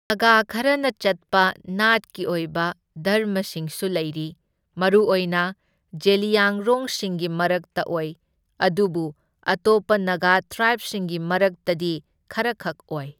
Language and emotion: Manipuri, neutral